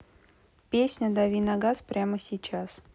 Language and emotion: Russian, neutral